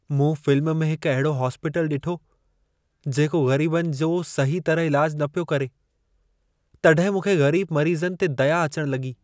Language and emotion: Sindhi, sad